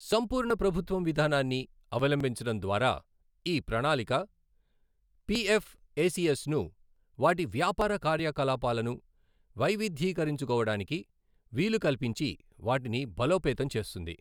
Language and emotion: Telugu, neutral